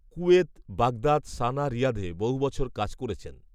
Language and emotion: Bengali, neutral